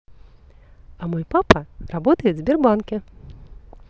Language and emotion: Russian, positive